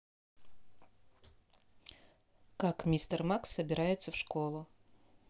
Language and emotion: Russian, neutral